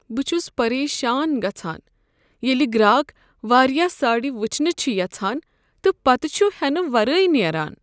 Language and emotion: Kashmiri, sad